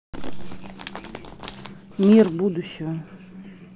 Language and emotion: Russian, neutral